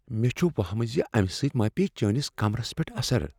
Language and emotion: Kashmiri, fearful